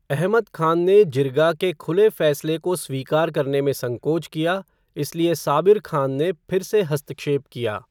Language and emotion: Hindi, neutral